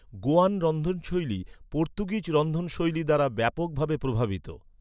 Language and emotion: Bengali, neutral